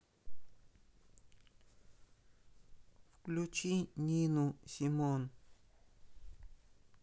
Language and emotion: Russian, neutral